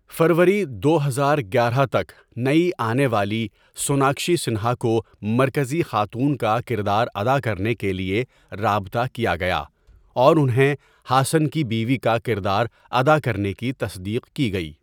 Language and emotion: Urdu, neutral